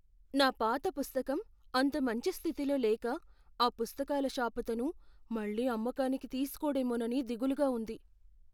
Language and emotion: Telugu, fearful